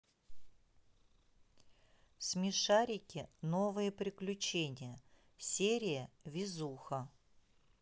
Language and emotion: Russian, neutral